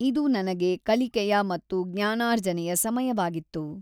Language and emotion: Kannada, neutral